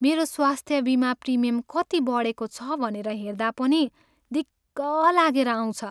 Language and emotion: Nepali, sad